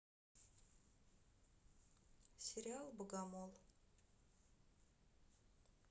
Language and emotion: Russian, sad